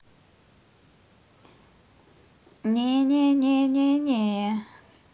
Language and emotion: Russian, positive